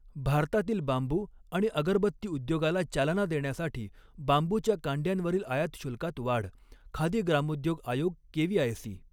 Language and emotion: Marathi, neutral